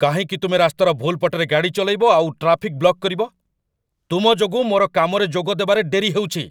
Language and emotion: Odia, angry